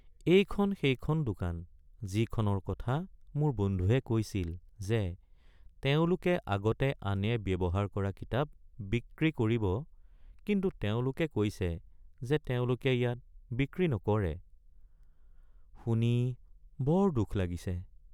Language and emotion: Assamese, sad